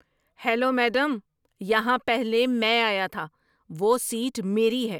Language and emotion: Urdu, angry